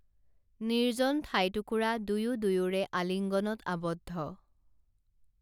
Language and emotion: Assamese, neutral